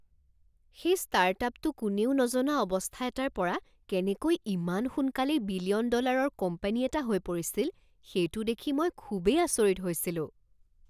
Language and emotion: Assamese, surprised